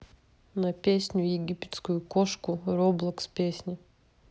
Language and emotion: Russian, neutral